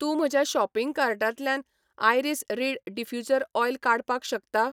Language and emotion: Goan Konkani, neutral